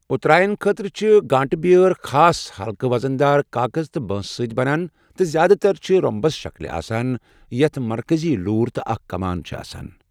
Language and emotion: Kashmiri, neutral